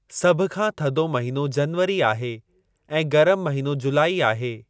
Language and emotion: Sindhi, neutral